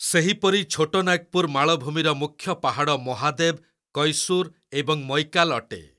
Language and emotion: Odia, neutral